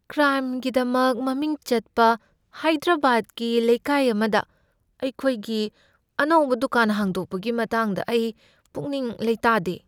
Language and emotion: Manipuri, fearful